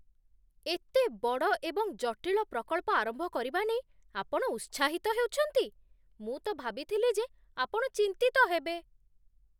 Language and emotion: Odia, surprised